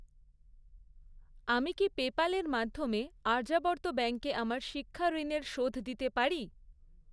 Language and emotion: Bengali, neutral